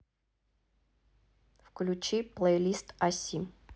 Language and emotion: Russian, neutral